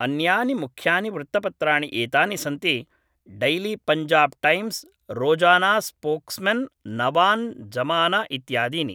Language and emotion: Sanskrit, neutral